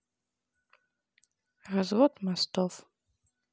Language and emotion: Russian, neutral